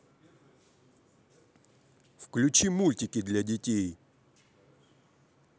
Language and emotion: Russian, neutral